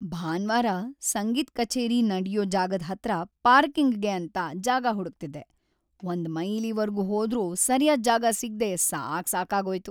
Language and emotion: Kannada, sad